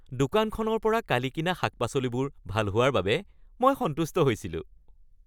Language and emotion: Assamese, happy